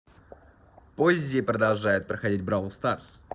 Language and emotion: Russian, positive